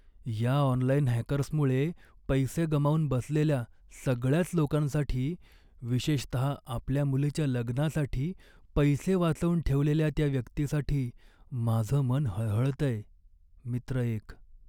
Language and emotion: Marathi, sad